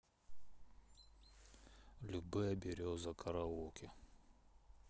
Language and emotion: Russian, sad